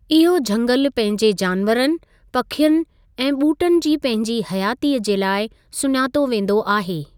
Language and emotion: Sindhi, neutral